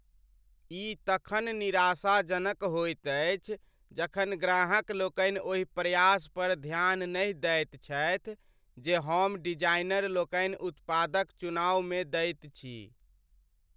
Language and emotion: Maithili, sad